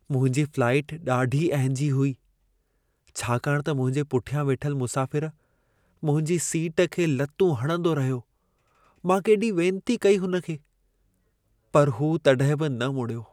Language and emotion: Sindhi, sad